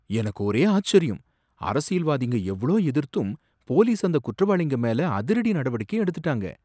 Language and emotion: Tamil, surprised